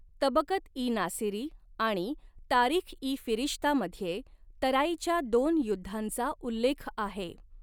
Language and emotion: Marathi, neutral